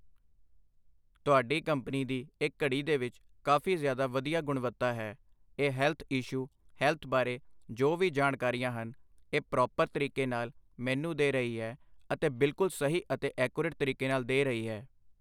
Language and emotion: Punjabi, neutral